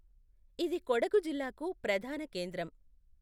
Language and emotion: Telugu, neutral